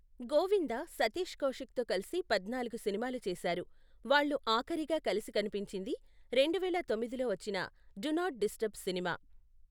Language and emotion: Telugu, neutral